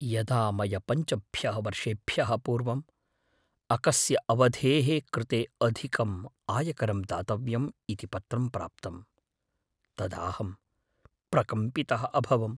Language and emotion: Sanskrit, fearful